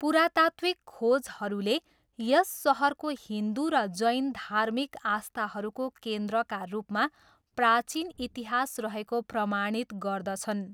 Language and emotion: Nepali, neutral